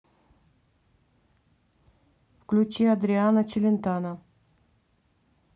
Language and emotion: Russian, neutral